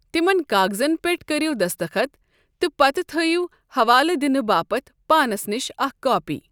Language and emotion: Kashmiri, neutral